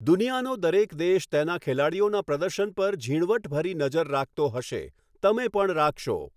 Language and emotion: Gujarati, neutral